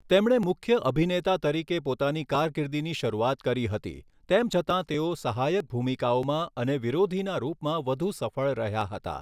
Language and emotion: Gujarati, neutral